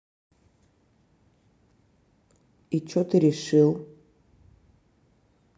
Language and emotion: Russian, neutral